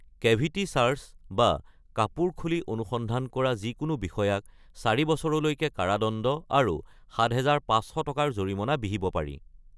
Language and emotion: Assamese, neutral